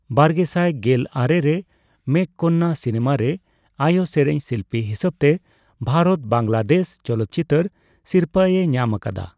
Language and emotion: Santali, neutral